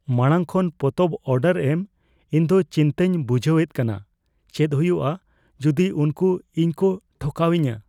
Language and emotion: Santali, fearful